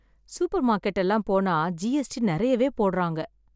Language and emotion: Tamil, sad